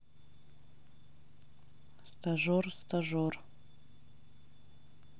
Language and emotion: Russian, neutral